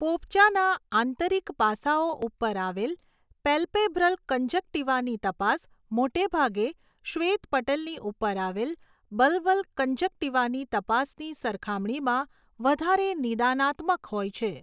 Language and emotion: Gujarati, neutral